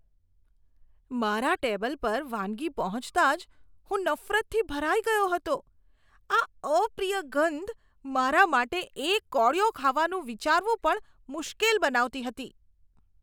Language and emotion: Gujarati, disgusted